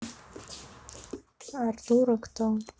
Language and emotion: Russian, neutral